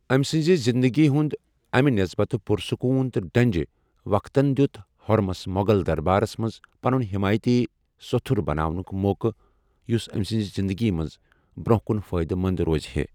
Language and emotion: Kashmiri, neutral